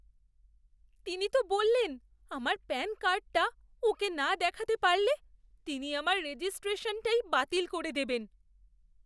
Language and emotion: Bengali, fearful